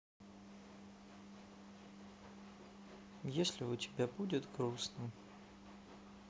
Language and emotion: Russian, sad